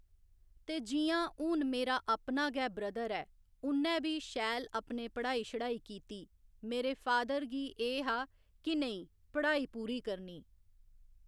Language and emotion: Dogri, neutral